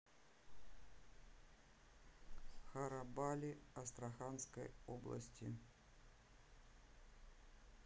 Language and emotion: Russian, neutral